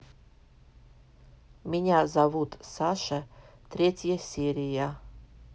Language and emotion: Russian, neutral